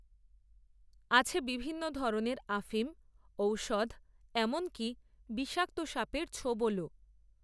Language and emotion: Bengali, neutral